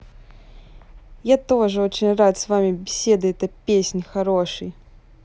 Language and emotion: Russian, positive